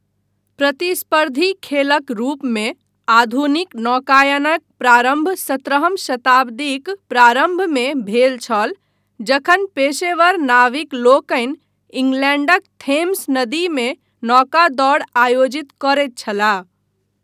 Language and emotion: Maithili, neutral